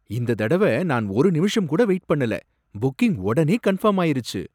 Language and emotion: Tamil, surprised